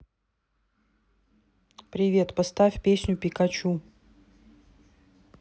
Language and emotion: Russian, neutral